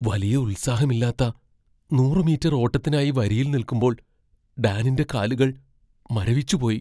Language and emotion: Malayalam, fearful